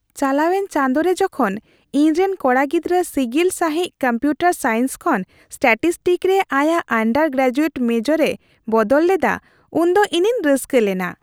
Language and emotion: Santali, happy